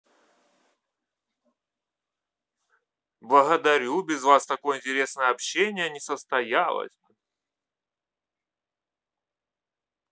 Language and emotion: Russian, positive